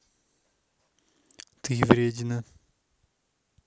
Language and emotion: Russian, neutral